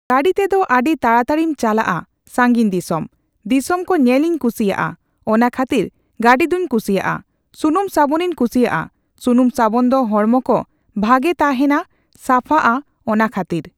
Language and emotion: Santali, neutral